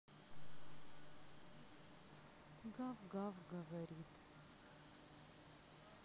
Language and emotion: Russian, sad